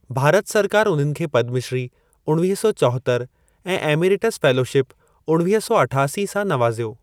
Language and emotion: Sindhi, neutral